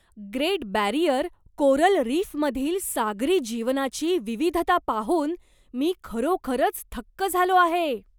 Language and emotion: Marathi, surprised